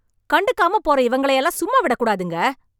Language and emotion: Tamil, angry